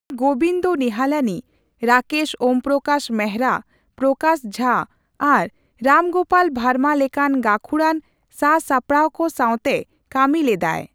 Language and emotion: Santali, neutral